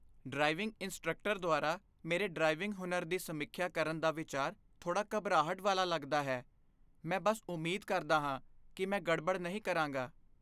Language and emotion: Punjabi, fearful